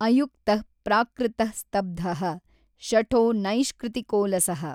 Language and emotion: Kannada, neutral